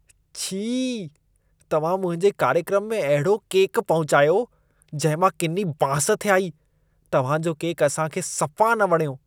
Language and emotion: Sindhi, disgusted